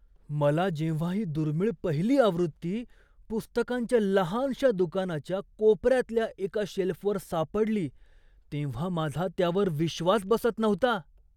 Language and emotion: Marathi, surprised